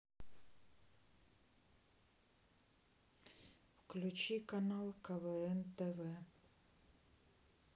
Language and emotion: Russian, neutral